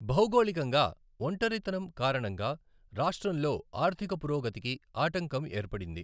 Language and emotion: Telugu, neutral